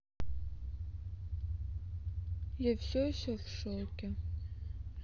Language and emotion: Russian, sad